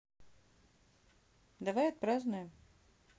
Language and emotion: Russian, neutral